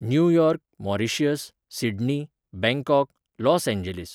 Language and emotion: Goan Konkani, neutral